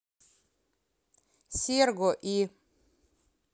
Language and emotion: Russian, neutral